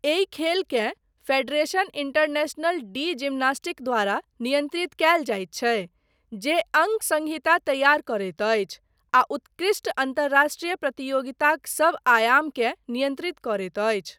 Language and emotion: Maithili, neutral